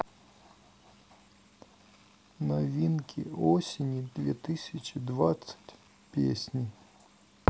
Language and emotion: Russian, sad